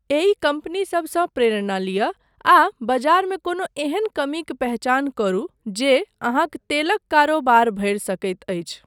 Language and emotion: Maithili, neutral